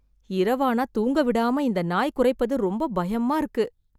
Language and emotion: Tamil, fearful